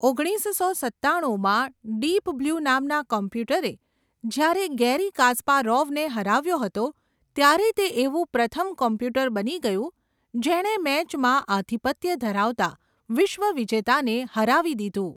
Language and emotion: Gujarati, neutral